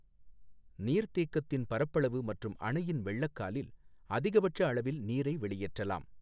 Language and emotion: Tamil, neutral